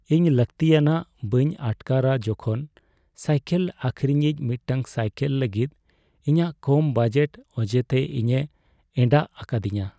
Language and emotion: Santali, sad